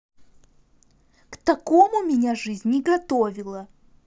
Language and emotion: Russian, angry